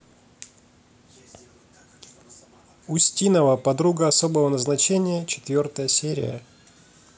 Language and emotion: Russian, neutral